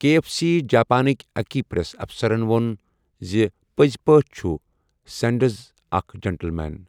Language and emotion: Kashmiri, neutral